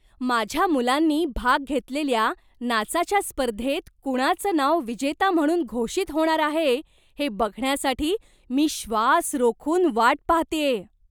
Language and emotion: Marathi, surprised